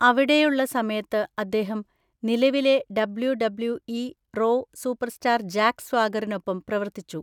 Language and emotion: Malayalam, neutral